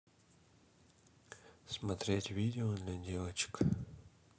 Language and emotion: Russian, neutral